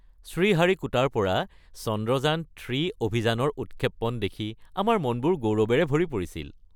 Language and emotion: Assamese, happy